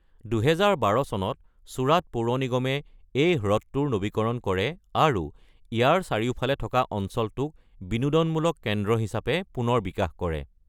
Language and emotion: Assamese, neutral